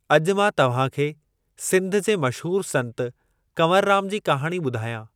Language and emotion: Sindhi, neutral